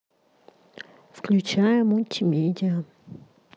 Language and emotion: Russian, neutral